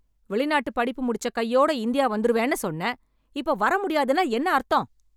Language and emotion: Tamil, angry